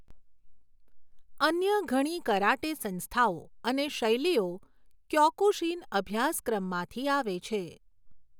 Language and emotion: Gujarati, neutral